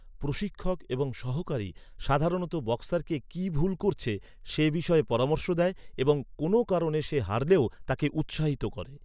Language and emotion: Bengali, neutral